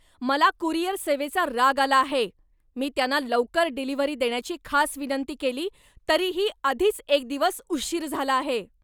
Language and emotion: Marathi, angry